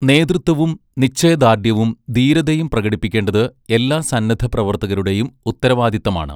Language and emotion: Malayalam, neutral